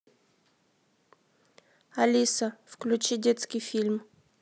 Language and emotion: Russian, neutral